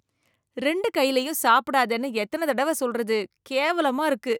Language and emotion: Tamil, disgusted